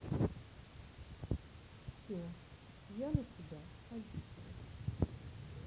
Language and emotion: Russian, sad